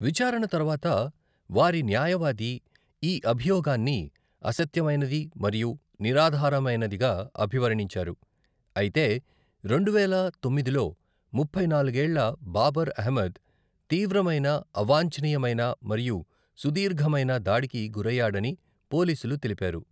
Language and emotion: Telugu, neutral